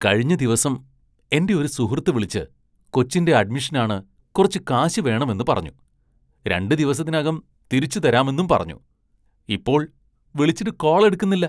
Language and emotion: Malayalam, disgusted